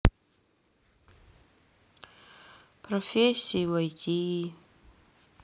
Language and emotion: Russian, sad